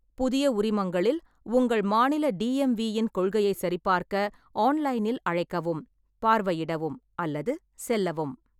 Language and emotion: Tamil, neutral